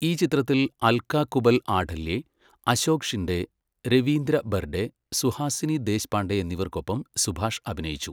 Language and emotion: Malayalam, neutral